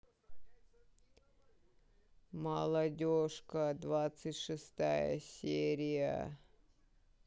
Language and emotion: Russian, sad